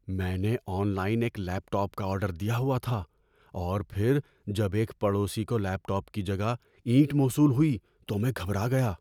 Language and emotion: Urdu, fearful